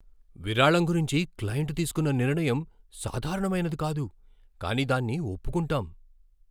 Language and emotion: Telugu, surprised